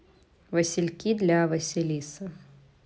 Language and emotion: Russian, neutral